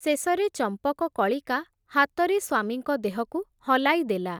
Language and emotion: Odia, neutral